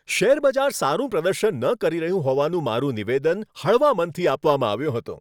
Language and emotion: Gujarati, happy